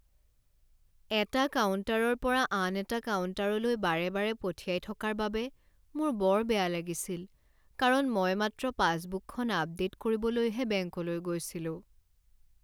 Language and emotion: Assamese, sad